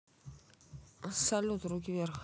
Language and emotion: Russian, neutral